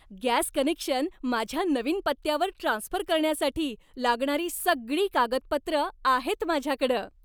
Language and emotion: Marathi, happy